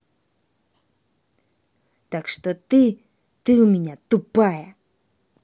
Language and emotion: Russian, angry